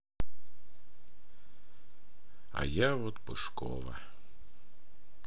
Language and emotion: Russian, sad